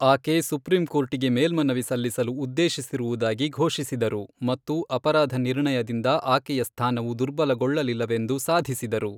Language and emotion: Kannada, neutral